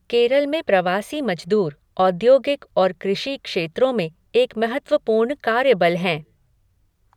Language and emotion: Hindi, neutral